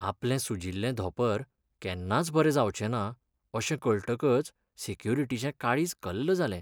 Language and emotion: Goan Konkani, sad